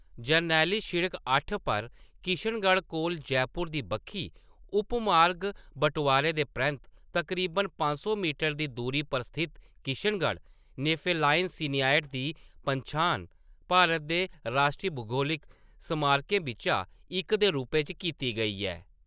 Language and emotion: Dogri, neutral